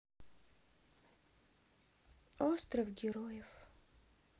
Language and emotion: Russian, sad